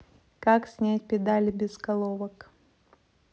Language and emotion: Russian, neutral